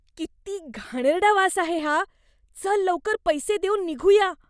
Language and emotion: Marathi, disgusted